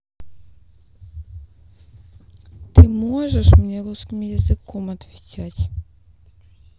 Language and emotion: Russian, sad